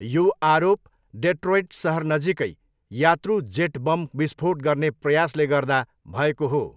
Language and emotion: Nepali, neutral